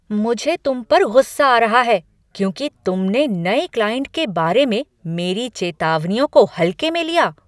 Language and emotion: Hindi, angry